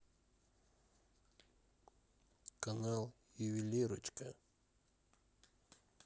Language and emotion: Russian, neutral